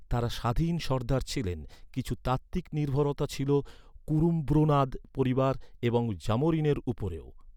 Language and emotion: Bengali, neutral